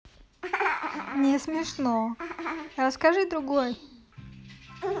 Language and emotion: Russian, positive